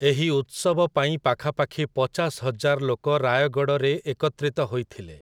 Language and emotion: Odia, neutral